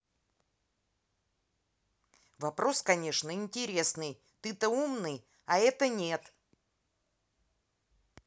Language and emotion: Russian, angry